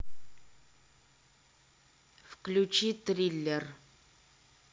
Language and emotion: Russian, neutral